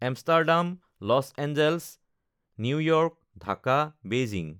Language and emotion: Assamese, neutral